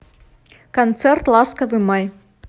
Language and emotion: Russian, neutral